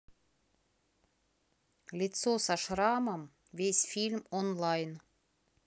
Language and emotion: Russian, neutral